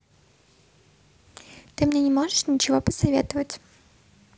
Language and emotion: Russian, neutral